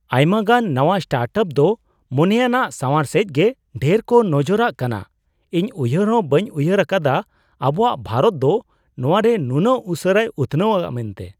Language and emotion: Santali, surprised